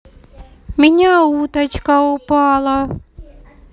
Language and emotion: Russian, neutral